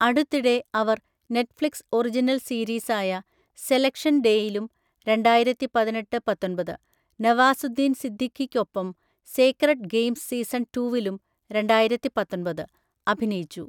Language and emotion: Malayalam, neutral